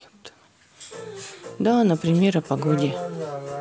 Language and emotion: Russian, neutral